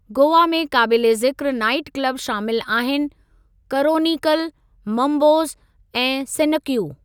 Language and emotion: Sindhi, neutral